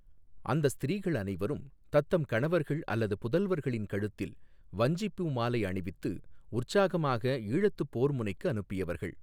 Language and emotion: Tamil, neutral